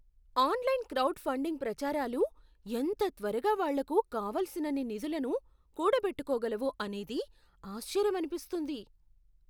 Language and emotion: Telugu, surprised